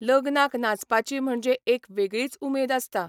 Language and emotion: Goan Konkani, neutral